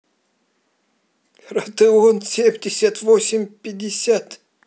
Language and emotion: Russian, positive